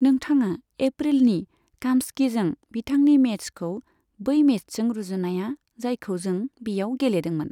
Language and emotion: Bodo, neutral